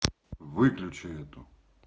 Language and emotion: Russian, neutral